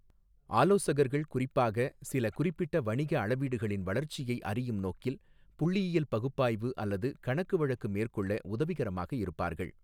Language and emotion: Tamil, neutral